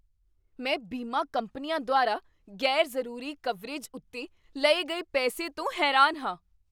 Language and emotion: Punjabi, surprised